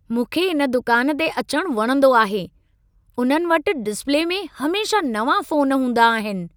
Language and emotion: Sindhi, happy